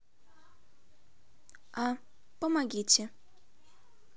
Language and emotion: Russian, neutral